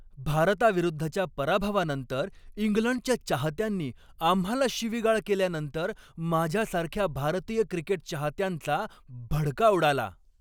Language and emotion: Marathi, angry